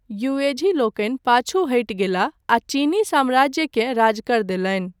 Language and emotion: Maithili, neutral